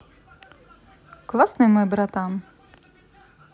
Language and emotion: Russian, positive